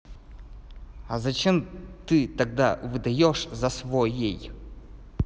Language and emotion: Russian, angry